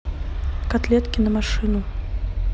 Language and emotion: Russian, neutral